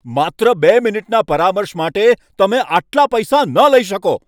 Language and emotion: Gujarati, angry